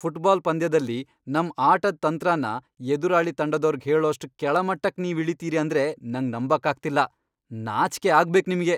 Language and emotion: Kannada, angry